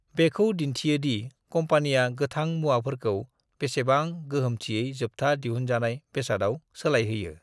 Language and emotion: Bodo, neutral